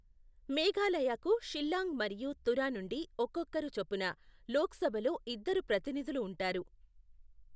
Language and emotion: Telugu, neutral